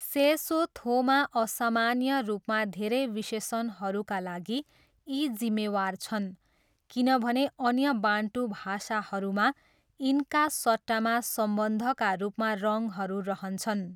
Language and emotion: Nepali, neutral